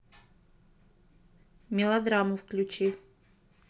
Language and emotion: Russian, neutral